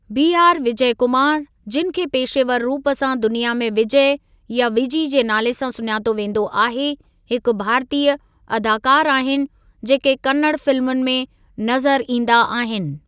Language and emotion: Sindhi, neutral